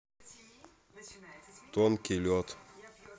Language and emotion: Russian, neutral